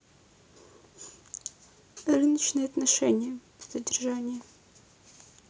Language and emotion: Russian, neutral